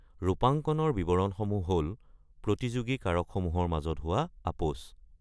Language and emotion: Assamese, neutral